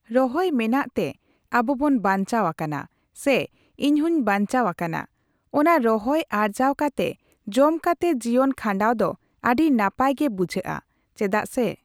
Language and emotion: Santali, neutral